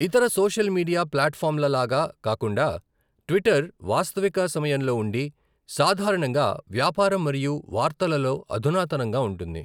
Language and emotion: Telugu, neutral